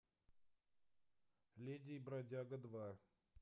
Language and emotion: Russian, neutral